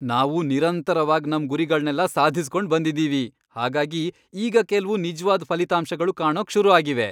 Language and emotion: Kannada, happy